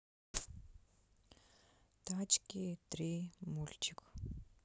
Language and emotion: Russian, neutral